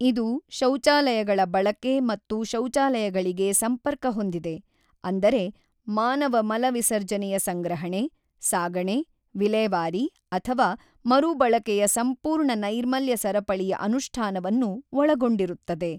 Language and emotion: Kannada, neutral